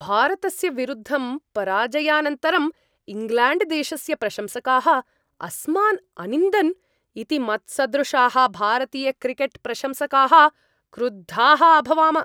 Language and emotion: Sanskrit, angry